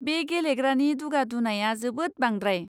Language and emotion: Bodo, disgusted